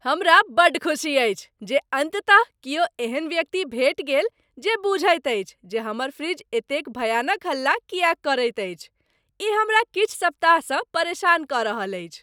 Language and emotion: Maithili, happy